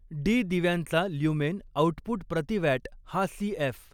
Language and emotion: Marathi, neutral